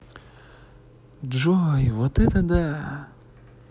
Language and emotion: Russian, positive